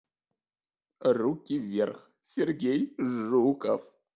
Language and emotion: Russian, positive